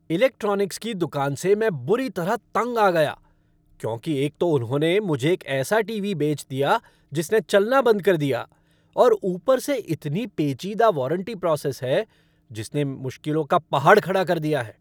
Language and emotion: Hindi, angry